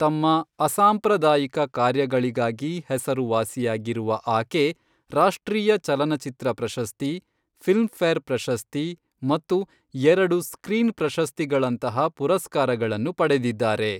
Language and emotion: Kannada, neutral